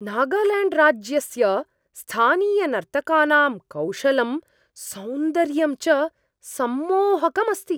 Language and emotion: Sanskrit, surprised